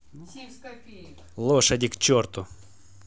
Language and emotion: Russian, angry